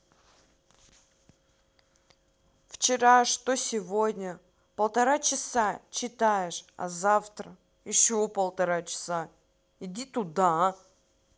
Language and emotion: Russian, angry